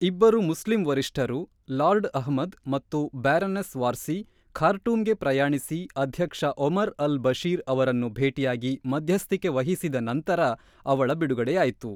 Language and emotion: Kannada, neutral